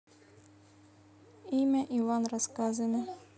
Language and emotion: Russian, neutral